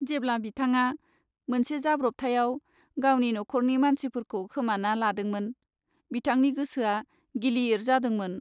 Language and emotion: Bodo, sad